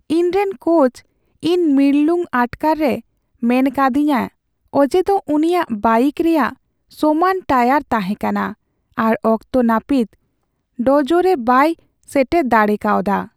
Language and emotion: Santali, sad